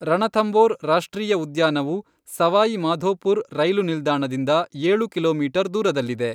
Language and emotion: Kannada, neutral